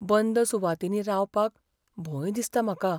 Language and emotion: Goan Konkani, fearful